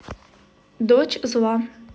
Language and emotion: Russian, neutral